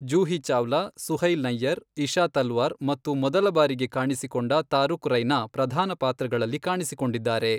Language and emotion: Kannada, neutral